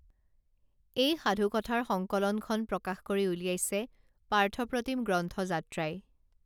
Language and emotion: Assamese, neutral